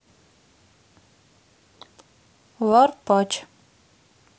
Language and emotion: Russian, neutral